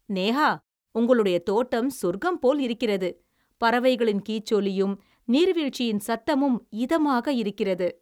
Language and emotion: Tamil, happy